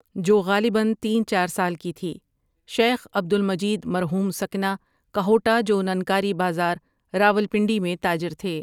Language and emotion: Urdu, neutral